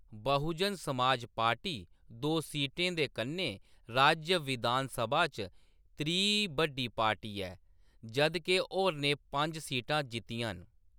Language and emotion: Dogri, neutral